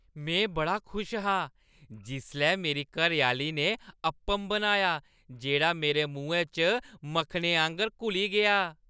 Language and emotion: Dogri, happy